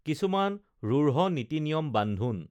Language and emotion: Assamese, neutral